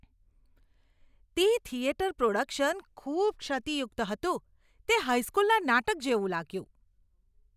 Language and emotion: Gujarati, disgusted